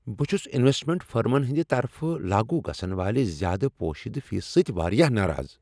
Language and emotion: Kashmiri, angry